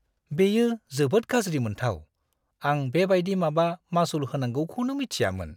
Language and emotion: Bodo, disgusted